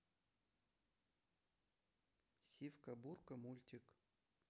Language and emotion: Russian, neutral